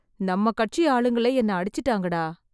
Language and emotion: Tamil, sad